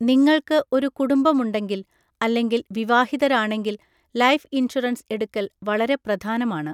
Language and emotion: Malayalam, neutral